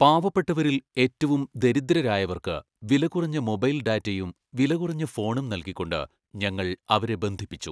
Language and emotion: Malayalam, neutral